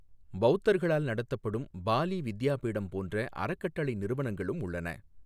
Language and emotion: Tamil, neutral